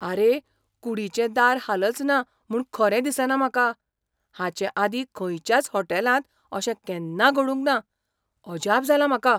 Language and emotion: Goan Konkani, surprised